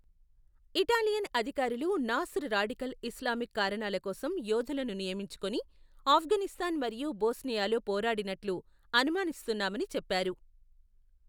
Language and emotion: Telugu, neutral